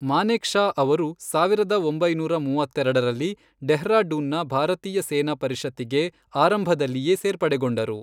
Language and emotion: Kannada, neutral